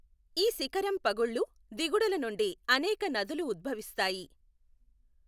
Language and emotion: Telugu, neutral